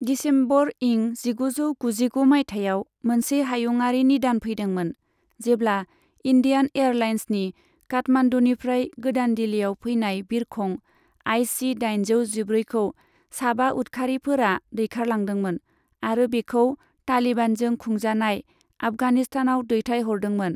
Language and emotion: Bodo, neutral